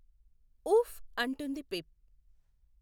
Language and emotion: Telugu, neutral